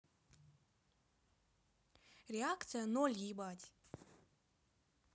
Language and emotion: Russian, angry